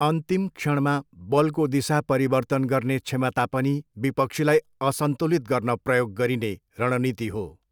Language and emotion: Nepali, neutral